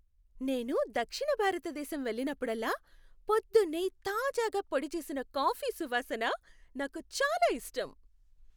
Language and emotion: Telugu, happy